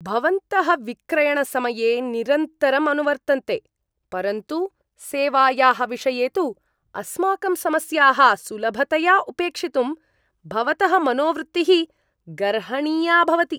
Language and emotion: Sanskrit, disgusted